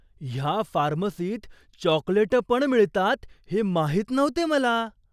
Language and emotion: Marathi, surprised